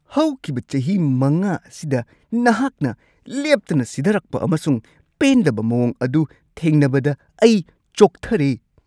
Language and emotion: Manipuri, disgusted